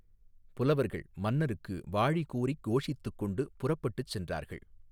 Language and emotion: Tamil, neutral